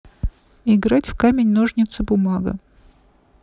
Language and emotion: Russian, neutral